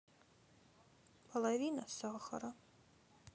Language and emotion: Russian, sad